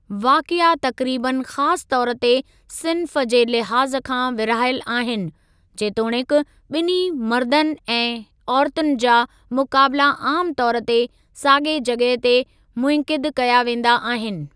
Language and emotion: Sindhi, neutral